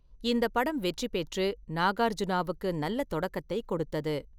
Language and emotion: Tamil, neutral